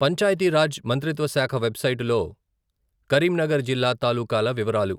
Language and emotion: Telugu, neutral